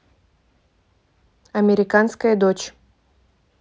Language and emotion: Russian, neutral